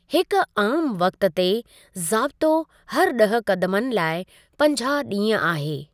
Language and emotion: Sindhi, neutral